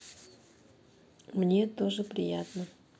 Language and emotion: Russian, neutral